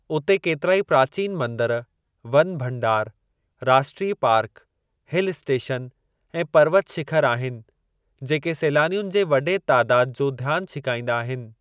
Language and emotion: Sindhi, neutral